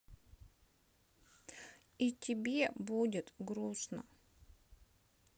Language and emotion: Russian, sad